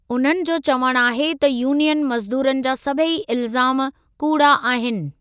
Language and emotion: Sindhi, neutral